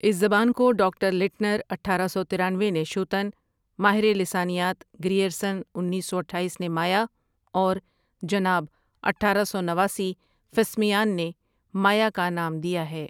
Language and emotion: Urdu, neutral